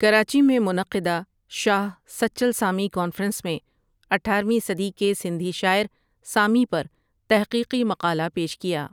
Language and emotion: Urdu, neutral